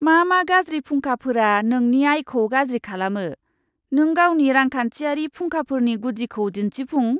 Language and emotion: Bodo, disgusted